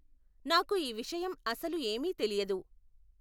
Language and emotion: Telugu, neutral